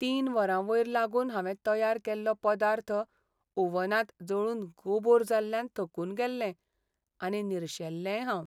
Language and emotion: Goan Konkani, sad